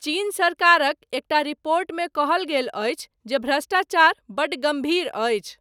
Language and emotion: Maithili, neutral